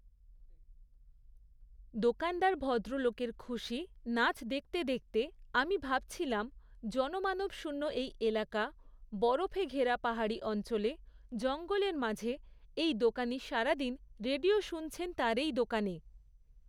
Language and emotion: Bengali, neutral